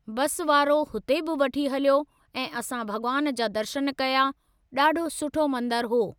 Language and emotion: Sindhi, neutral